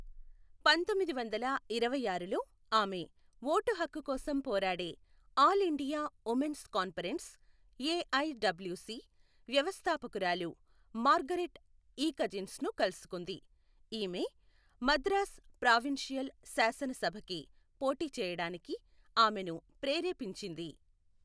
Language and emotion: Telugu, neutral